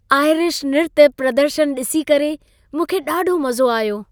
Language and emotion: Sindhi, happy